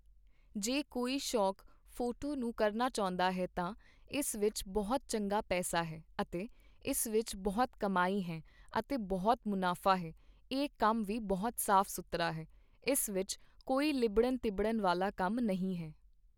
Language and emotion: Punjabi, neutral